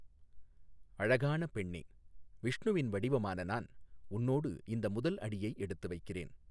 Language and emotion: Tamil, neutral